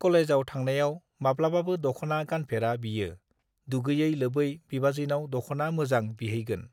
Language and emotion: Bodo, neutral